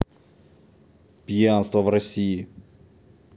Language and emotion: Russian, neutral